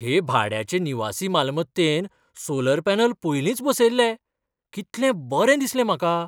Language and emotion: Goan Konkani, surprised